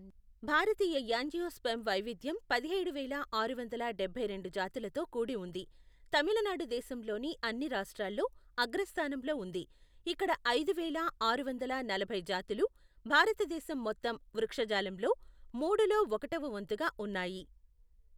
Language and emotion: Telugu, neutral